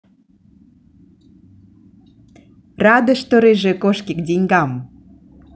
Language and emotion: Russian, positive